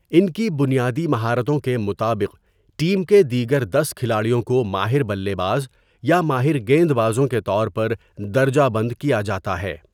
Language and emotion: Urdu, neutral